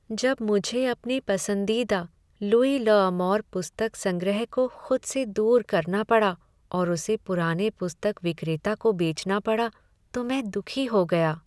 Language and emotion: Hindi, sad